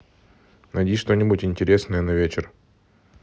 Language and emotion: Russian, neutral